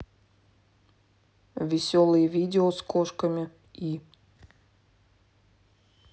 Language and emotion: Russian, neutral